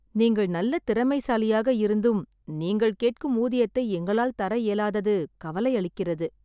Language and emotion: Tamil, sad